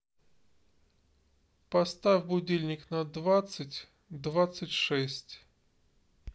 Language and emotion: Russian, neutral